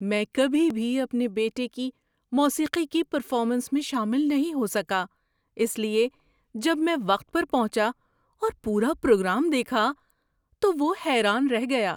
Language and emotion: Urdu, surprised